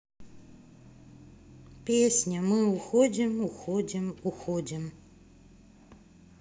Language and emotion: Russian, sad